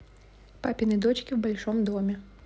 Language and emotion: Russian, neutral